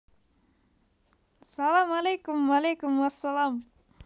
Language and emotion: Russian, positive